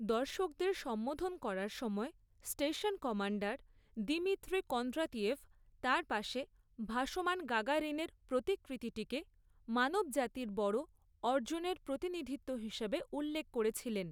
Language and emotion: Bengali, neutral